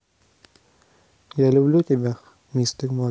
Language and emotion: Russian, neutral